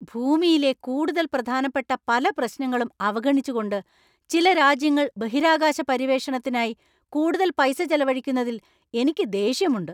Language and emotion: Malayalam, angry